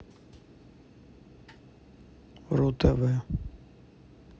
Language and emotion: Russian, neutral